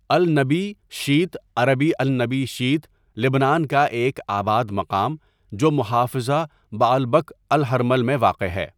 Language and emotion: Urdu, neutral